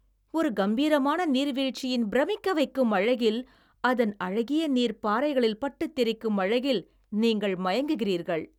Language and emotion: Tamil, happy